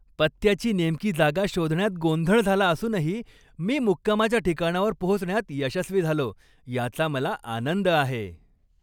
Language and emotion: Marathi, happy